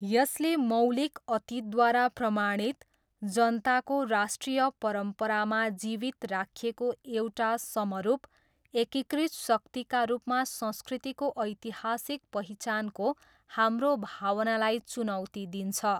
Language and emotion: Nepali, neutral